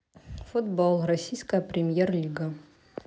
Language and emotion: Russian, neutral